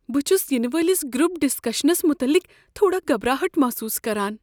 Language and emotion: Kashmiri, fearful